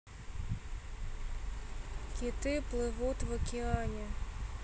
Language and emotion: Russian, neutral